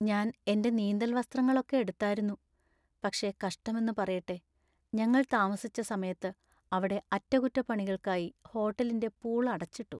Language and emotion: Malayalam, sad